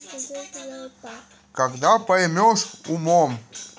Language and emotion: Russian, neutral